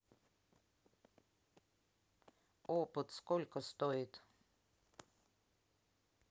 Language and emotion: Russian, neutral